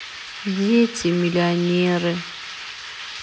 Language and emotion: Russian, sad